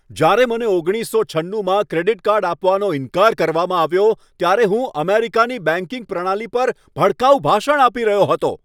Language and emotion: Gujarati, angry